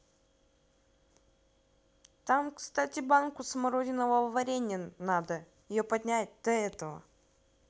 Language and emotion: Russian, neutral